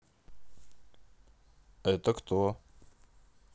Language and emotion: Russian, neutral